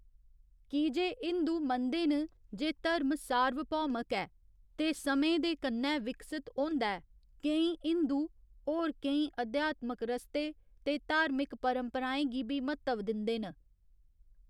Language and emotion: Dogri, neutral